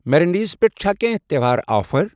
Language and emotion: Kashmiri, neutral